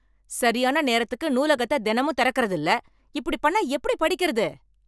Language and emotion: Tamil, angry